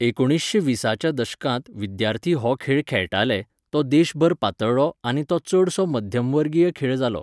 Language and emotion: Goan Konkani, neutral